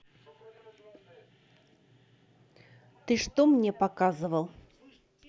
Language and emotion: Russian, neutral